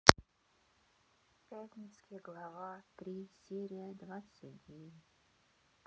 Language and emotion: Russian, sad